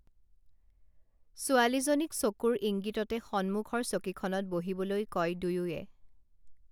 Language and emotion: Assamese, neutral